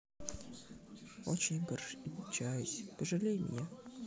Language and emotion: Russian, sad